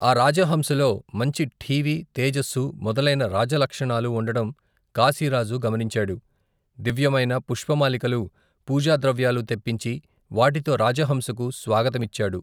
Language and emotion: Telugu, neutral